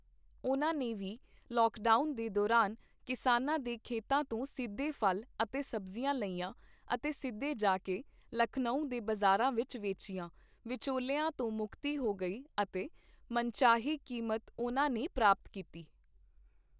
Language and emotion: Punjabi, neutral